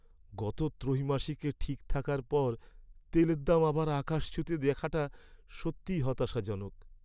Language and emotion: Bengali, sad